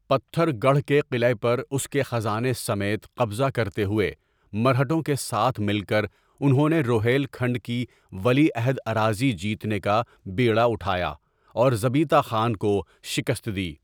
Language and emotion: Urdu, neutral